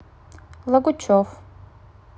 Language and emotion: Russian, neutral